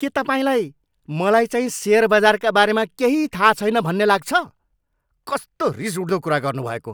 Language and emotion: Nepali, angry